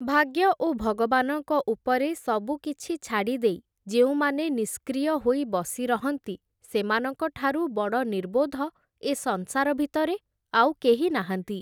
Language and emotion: Odia, neutral